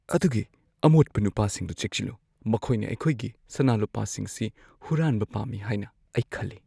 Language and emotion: Manipuri, fearful